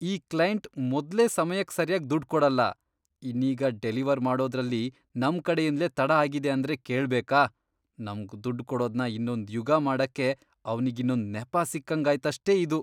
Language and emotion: Kannada, disgusted